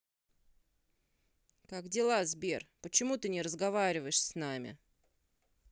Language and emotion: Russian, sad